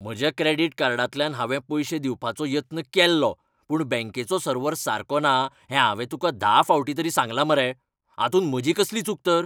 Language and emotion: Goan Konkani, angry